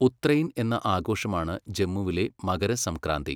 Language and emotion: Malayalam, neutral